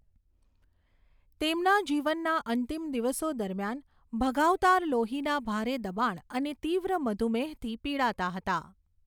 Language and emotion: Gujarati, neutral